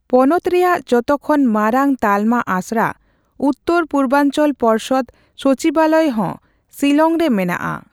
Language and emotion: Santali, neutral